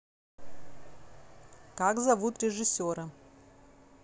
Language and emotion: Russian, neutral